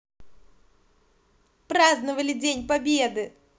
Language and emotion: Russian, positive